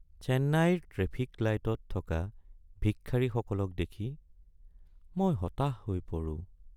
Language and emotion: Assamese, sad